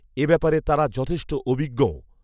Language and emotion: Bengali, neutral